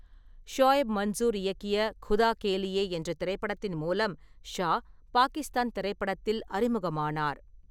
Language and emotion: Tamil, neutral